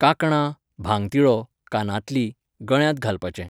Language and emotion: Goan Konkani, neutral